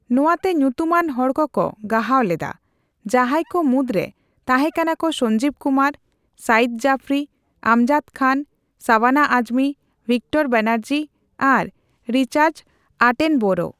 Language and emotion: Santali, neutral